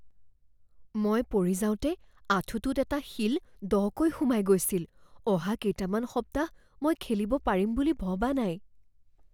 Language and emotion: Assamese, fearful